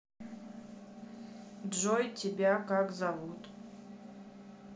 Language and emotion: Russian, neutral